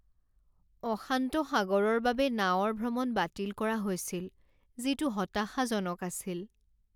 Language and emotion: Assamese, sad